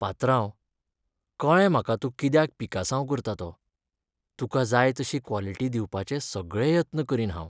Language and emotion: Goan Konkani, sad